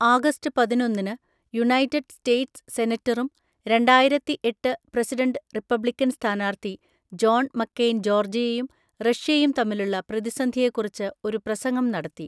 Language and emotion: Malayalam, neutral